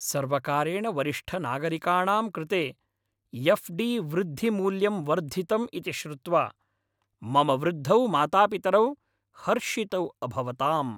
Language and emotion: Sanskrit, happy